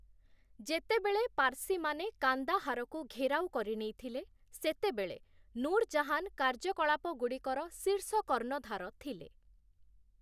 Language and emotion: Odia, neutral